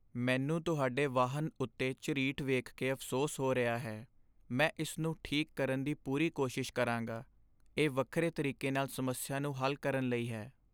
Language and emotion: Punjabi, sad